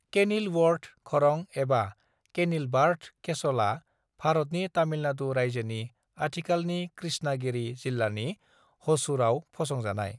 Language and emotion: Bodo, neutral